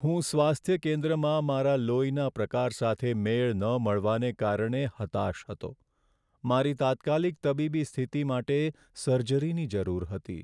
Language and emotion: Gujarati, sad